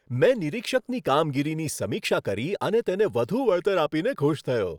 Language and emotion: Gujarati, happy